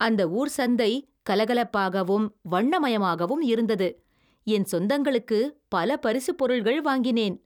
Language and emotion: Tamil, happy